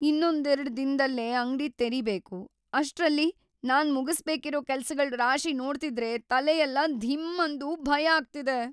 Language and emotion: Kannada, fearful